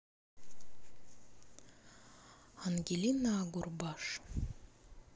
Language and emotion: Russian, neutral